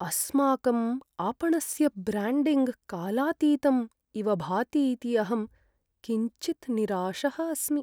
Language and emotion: Sanskrit, sad